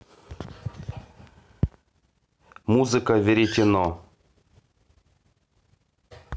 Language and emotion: Russian, neutral